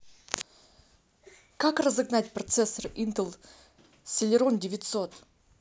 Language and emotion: Russian, neutral